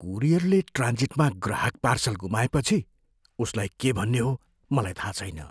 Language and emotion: Nepali, fearful